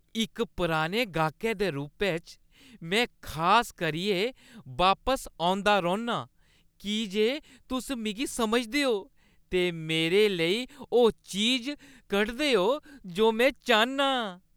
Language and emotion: Dogri, happy